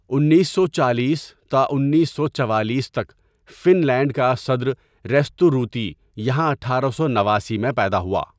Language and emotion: Urdu, neutral